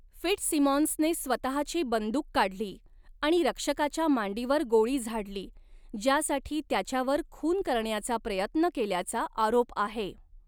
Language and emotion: Marathi, neutral